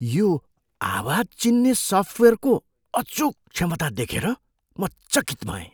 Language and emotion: Nepali, surprised